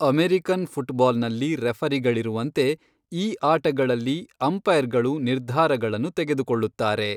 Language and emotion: Kannada, neutral